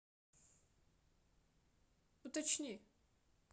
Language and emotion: Russian, neutral